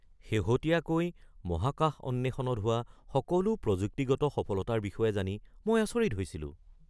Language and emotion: Assamese, surprised